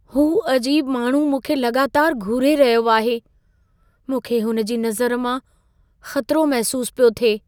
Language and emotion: Sindhi, fearful